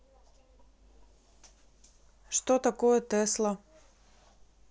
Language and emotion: Russian, neutral